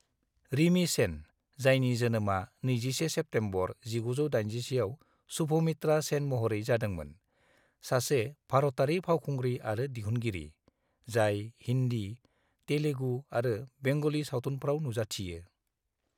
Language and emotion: Bodo, neutral